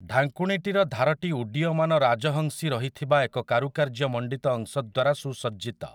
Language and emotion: Odia, neutral